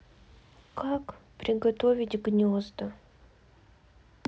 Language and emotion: Russian, sad